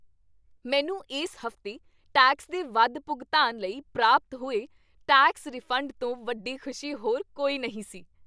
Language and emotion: Punjabi, happy